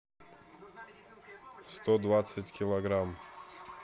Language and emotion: Russian, neutral